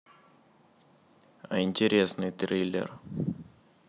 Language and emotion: Russian, neutral